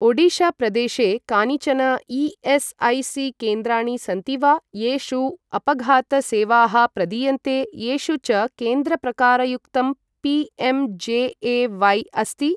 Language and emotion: Sanskrit, neutral